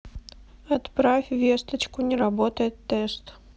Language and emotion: Russian, neutral